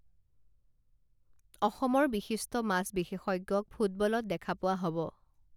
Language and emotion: Assamese, neutral